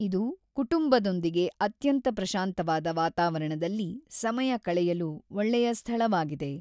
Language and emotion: Kannada, neutral